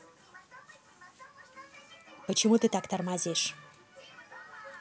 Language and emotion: Russian, angry